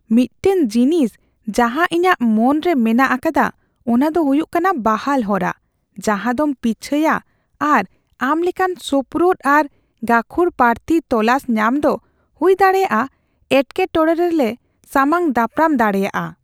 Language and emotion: Santali, fearful